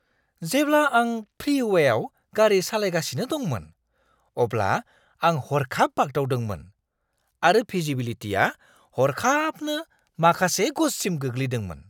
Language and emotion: Bodo, surprised